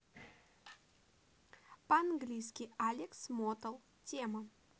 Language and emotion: Russian, neutral